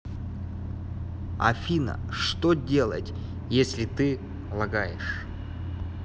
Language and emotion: Russian, neutral